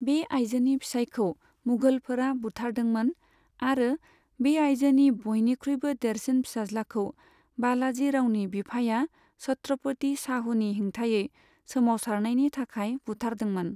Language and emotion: Bodo, neutral